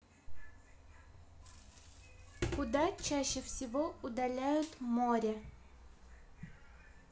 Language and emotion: Russian, neutral